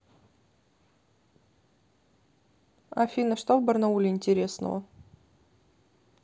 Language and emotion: Russian, neutral